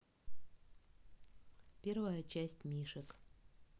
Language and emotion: Russian, neutral